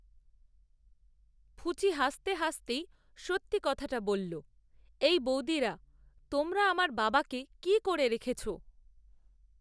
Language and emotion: Bengali, neutral